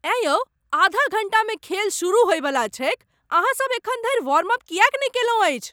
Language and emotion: Maithili, angry